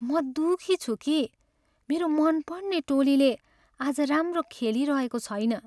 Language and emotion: Nepali, sad